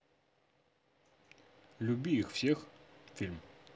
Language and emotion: Russian, neutral